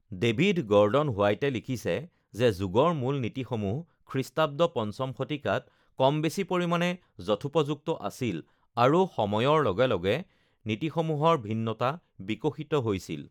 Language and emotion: Assamese, neutral